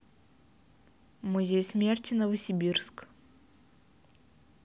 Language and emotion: Russian, neutral